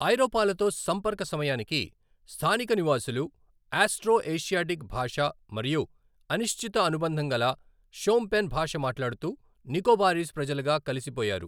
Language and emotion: Telugu, neutral